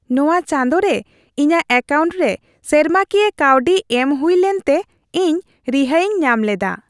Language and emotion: Santali, happy